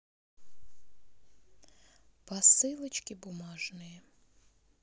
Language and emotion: Russian, neutral